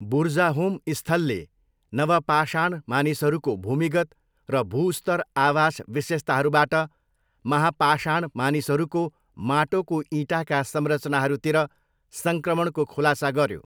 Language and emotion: Nepali, neutral